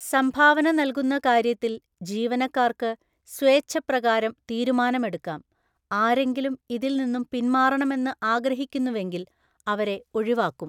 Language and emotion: Malayalam, neutral